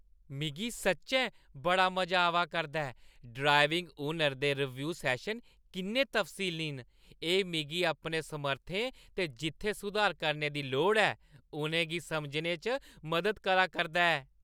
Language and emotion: Dogri, happy